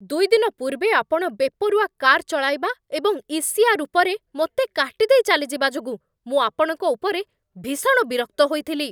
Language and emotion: Odia, angry